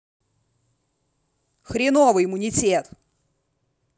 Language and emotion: Russian, angry